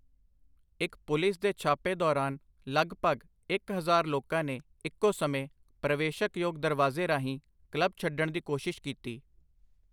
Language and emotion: Punjabi, neutral